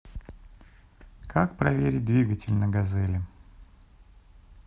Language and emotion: Russian, neutral